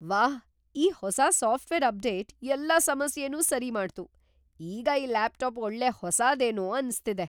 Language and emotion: Kannada, surprised